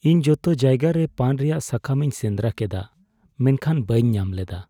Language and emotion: Santali, sad